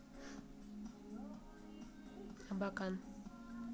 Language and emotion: Russian, neutral